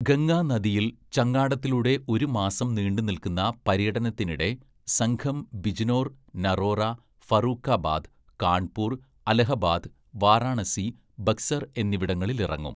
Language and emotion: Malayalam, neutral